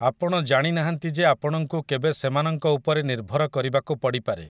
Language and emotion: Odia, neutral